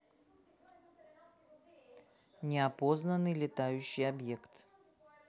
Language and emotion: Russian, neutral